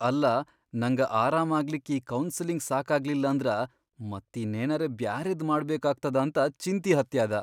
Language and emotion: Kannada, fearful